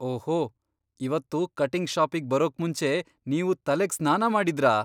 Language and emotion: Kannada, surprised